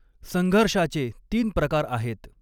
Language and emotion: Marathi, neutral